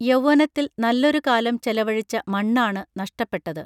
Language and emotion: Malayalam, neutral